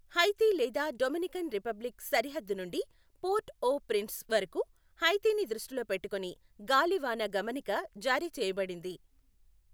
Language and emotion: Telugu, neutral